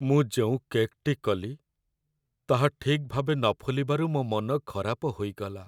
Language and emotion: Odia, sad